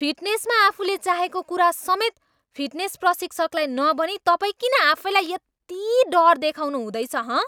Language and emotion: Nepali, angry